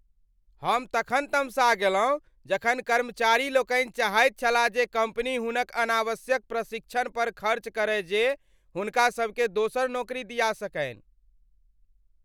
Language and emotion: Maithili, angry